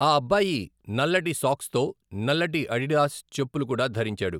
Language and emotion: Telugu, neutral